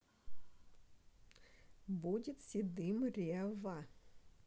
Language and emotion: Russian, neutral